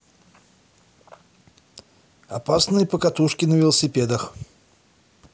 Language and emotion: Russian, positive